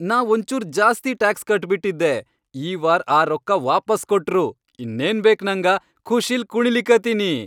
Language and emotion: Kannada, happy